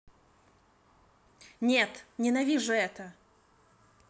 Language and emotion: Russian, angry